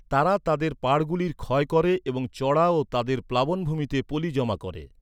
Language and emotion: Bengali, neutral